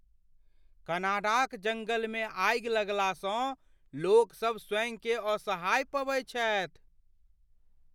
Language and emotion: Maithili, fearful